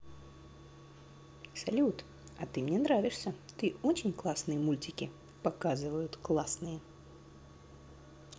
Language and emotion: Russian, positive